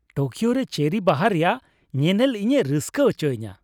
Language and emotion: Santali, happy